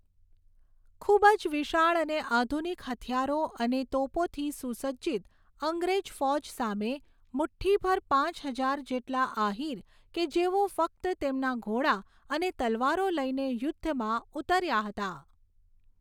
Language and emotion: Gujarati, neutral